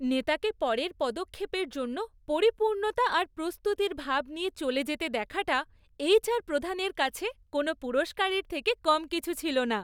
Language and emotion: Bengali, happy